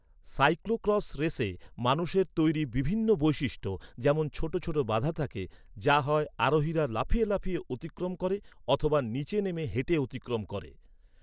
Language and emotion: Bengali, neutral